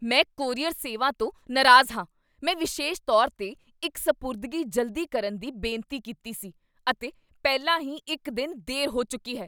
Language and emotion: Punjabi, angry